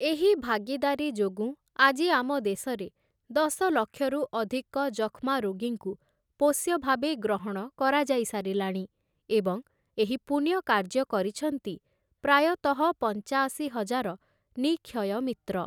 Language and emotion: Odia, neutral